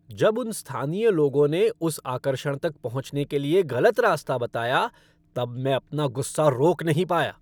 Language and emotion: Hindi, angry